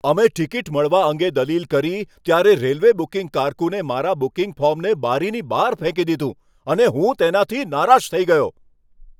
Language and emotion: Gujarati, angry